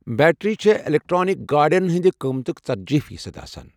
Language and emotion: Kashmiri, neutral